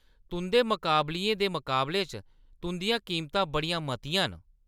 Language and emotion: Dogri, angry